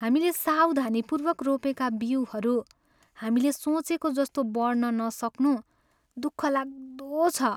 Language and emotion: Nepali, sad